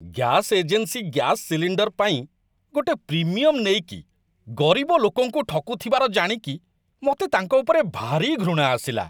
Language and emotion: Odia, disgusted